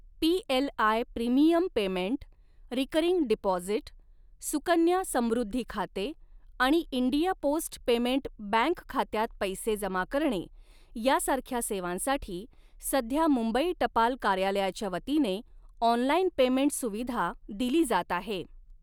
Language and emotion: Marathi, neutral